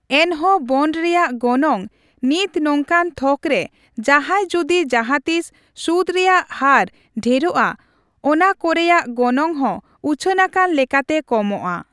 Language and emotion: Santali, neutral